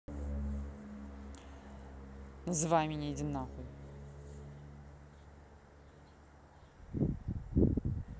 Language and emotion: Russian, angry